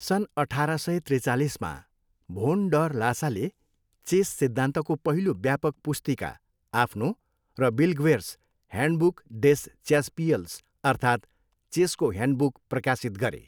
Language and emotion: Nepali, neutral